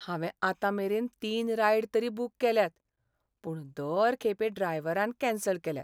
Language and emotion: Goan Konkani, sad